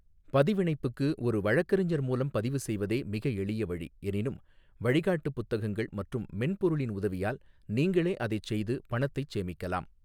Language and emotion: Tamil, neutral